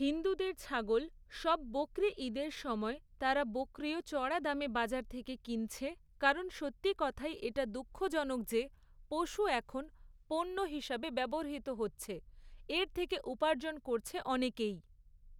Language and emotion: Bengali, neutral